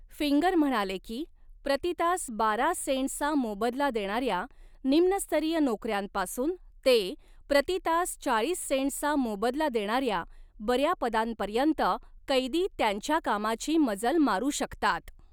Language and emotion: Marathi, neutral